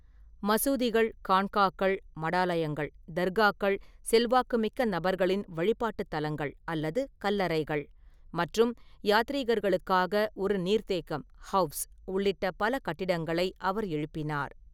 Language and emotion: Tamil, neutral